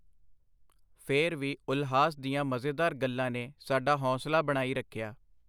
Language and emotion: Punjabi, neutral